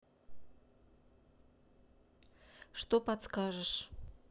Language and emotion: Russian, neutral